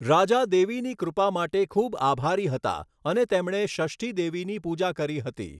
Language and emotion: Gujarati, neutral